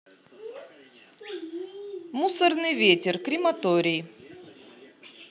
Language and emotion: Russian, neutral